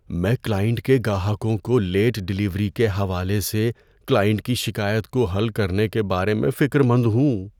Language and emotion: Urdu, fearful